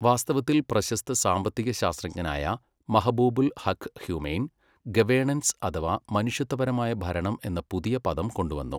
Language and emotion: Malayalam, neutral